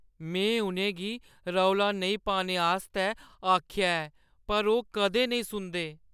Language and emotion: Dogri, sad